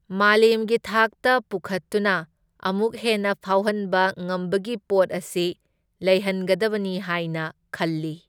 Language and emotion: Manipuri, neutral